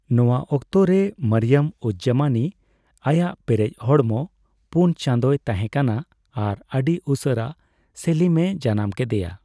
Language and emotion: Santali, neutral